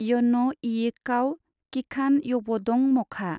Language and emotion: Bodo, neutral